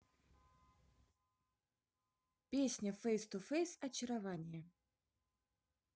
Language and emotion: Russian, positive